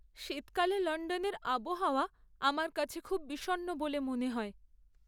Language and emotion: Bengali, sad